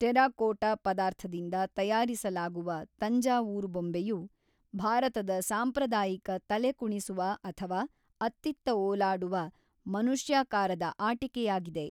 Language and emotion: Kannada, neutral